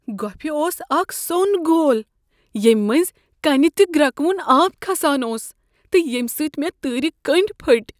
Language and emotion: Kashmiri, fearful